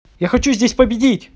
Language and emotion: Russian, neutral